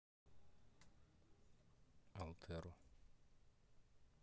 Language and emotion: Russian, neutral